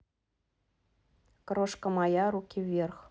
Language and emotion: Russian, neutral